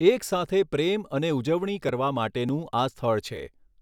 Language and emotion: Gujarati, neutral